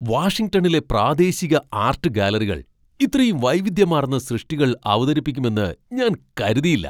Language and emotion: Malayalam, surprised